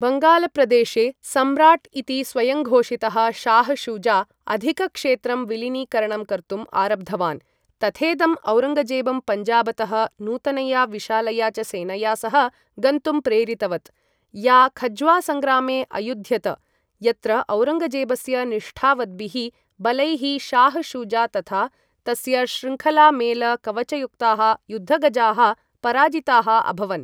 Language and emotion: Sanskrit, neutral